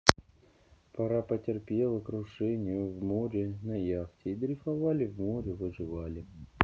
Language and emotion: Russian, neutral